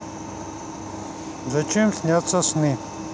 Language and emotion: Russian, neutral